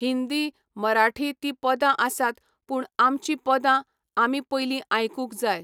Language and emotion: Goan Konkani, neutral